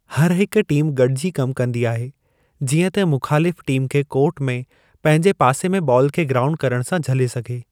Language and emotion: Sindhi, neutral